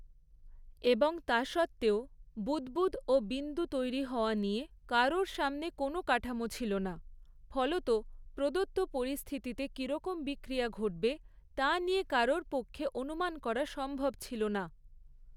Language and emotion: Bengali, neutral